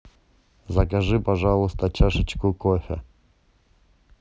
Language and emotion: Russian, neutral